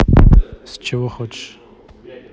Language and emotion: Russian, neutral